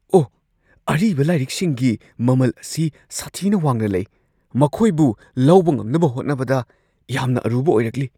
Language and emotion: Manipuri, surprised